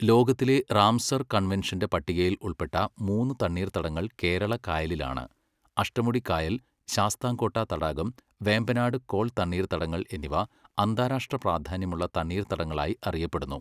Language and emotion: Malayalam, neutral